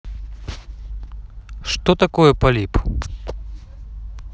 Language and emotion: Russian, neutral